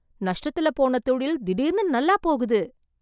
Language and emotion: Tamil, surprised